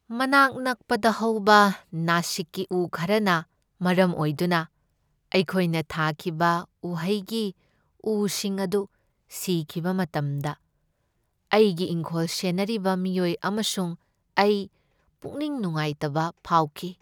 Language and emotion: Manipuri, sad